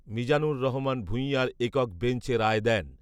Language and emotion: Bengali, neutral